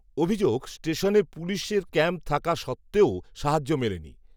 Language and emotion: Bengali, neutral